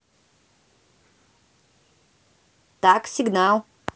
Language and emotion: Russian, neutral